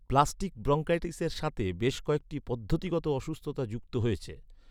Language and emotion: Bengali, neutral